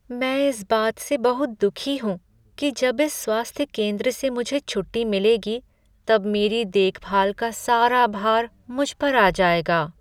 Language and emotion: Hindi, sad